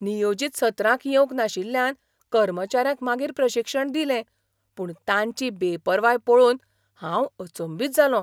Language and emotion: Goan Konkani, surprised